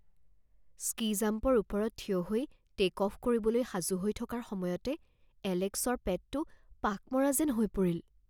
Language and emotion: Assamese, fearful